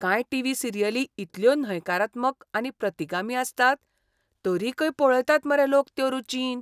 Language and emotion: Goan Konkani, disgusted